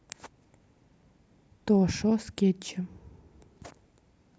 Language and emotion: Russian, neutral